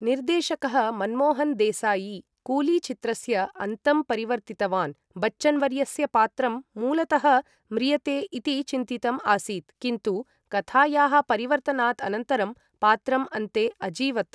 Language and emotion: Sanskrit, neutral